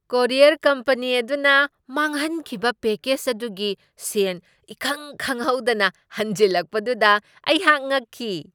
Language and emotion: Manipuri, surprised